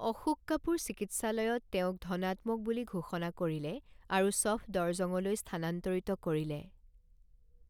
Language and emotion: Assamese, neutral